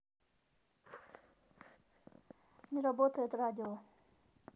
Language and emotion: Russian, neutral